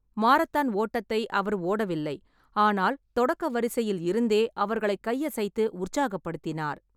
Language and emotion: Tamil, neutral